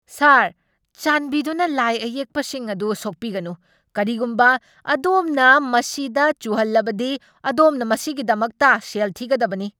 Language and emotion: Manipuri, angry